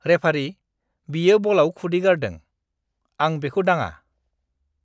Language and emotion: Bodo, disgusted